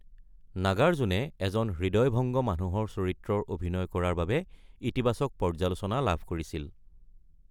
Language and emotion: Assamese, neutral